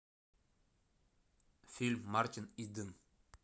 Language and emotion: Russian, neutral